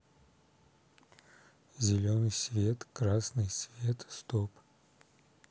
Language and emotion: Russian, neutral